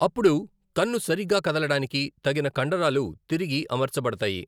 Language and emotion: Telugu, neutral